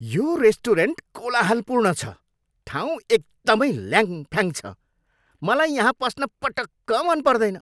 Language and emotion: Nepali, angry